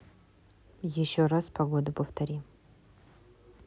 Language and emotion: Russian, neutral